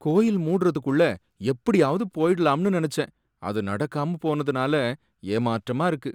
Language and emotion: Tamil, sad